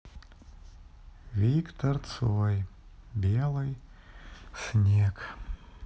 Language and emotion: Russian, sad